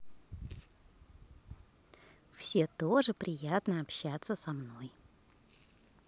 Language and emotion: Russian, positive